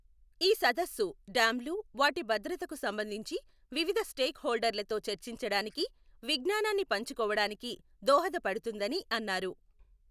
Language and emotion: Telugu, neutral